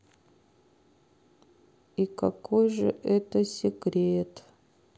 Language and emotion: Russian, sad